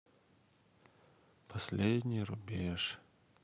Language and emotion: Russian, sad